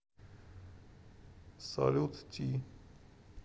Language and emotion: Russian, neutral